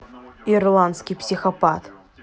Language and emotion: Russian, neutral